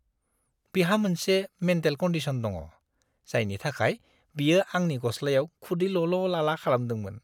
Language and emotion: Bodo, disgusted